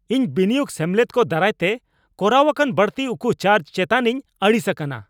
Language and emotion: Santali, angry